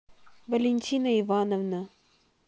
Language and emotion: Russian, neutral